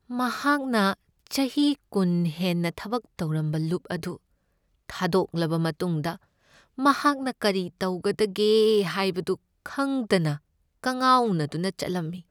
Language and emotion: Manipuri, sad